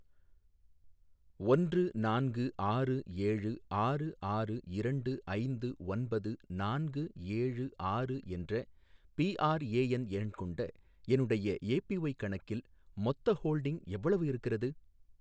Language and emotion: Tamil, neutral